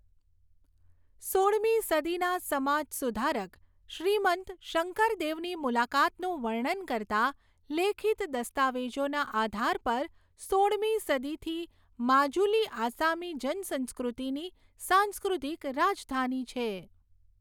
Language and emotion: Gujarati, neutral